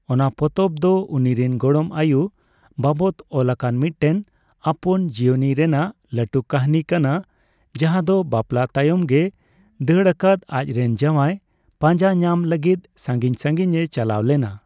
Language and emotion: Santali, neutral